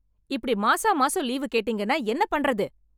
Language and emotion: Tamil, angry